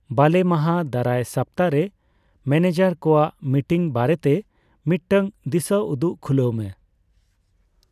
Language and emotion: Santali, neutral